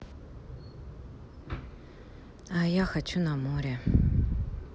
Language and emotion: Russian, sad